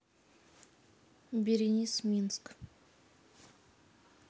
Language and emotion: Russian, neutral